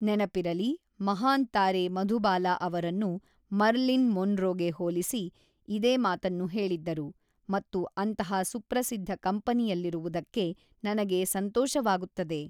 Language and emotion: Kannada, neutral